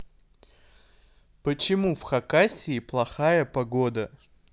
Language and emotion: Russian, neutral